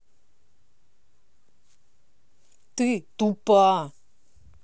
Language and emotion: Russian, angry